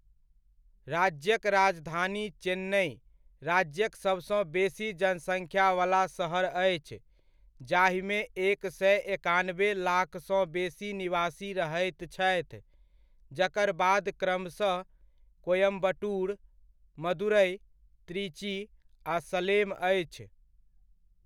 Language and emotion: Maithili, neutral